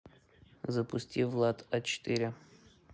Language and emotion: Russian, neutral